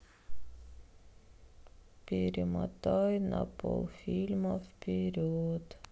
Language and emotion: Russian, sad